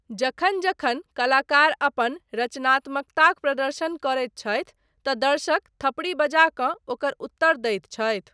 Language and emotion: Maithili, neutral